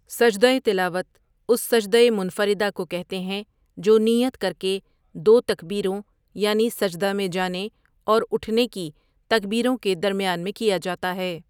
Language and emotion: Urdu, neutral